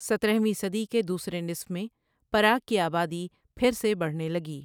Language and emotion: Urdu, neutral